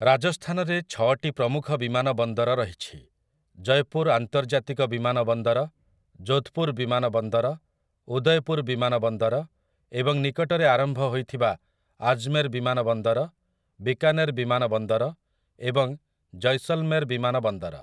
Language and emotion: Odia, neutral